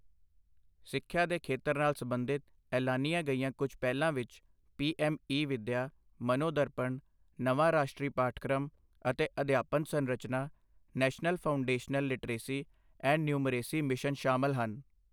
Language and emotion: Punjabi, neutral